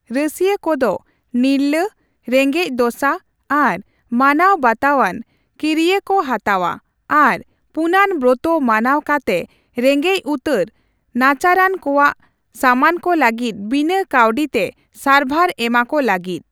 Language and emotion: Santali, neutral